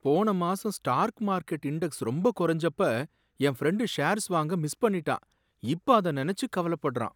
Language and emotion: Tamil, sad